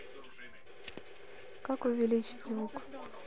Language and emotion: Russian, neutral